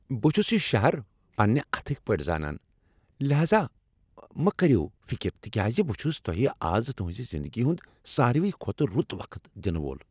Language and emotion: Kashmiri, happy